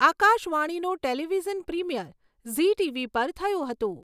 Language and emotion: Gujarati, neutral